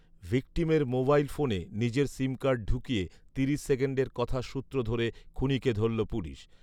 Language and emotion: Bengali, neutral